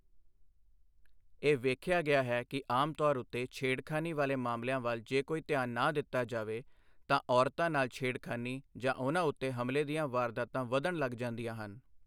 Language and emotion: Punjabi, neutral